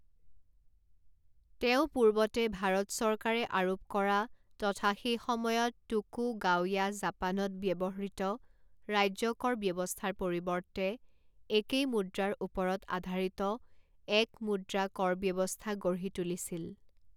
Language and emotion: Assamese, neutral